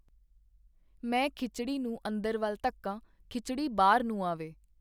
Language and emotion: Punjabi, neutral